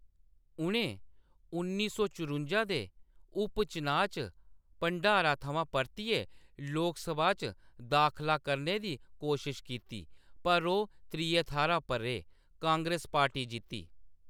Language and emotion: Dogri, neutral